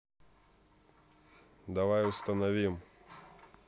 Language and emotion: Russian, neutral